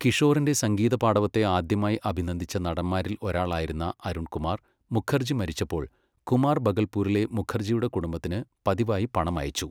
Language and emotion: Malayalam, neutral